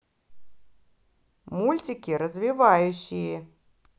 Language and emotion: Russian, positive